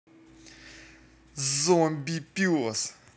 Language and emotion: Russian, angry